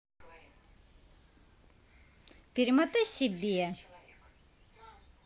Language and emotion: Russian, angry